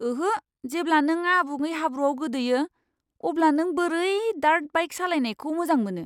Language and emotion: Bodo, disgusted